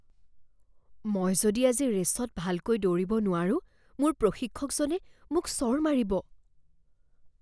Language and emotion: Assamese, fearful